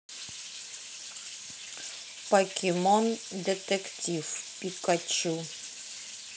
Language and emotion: Russian, neutral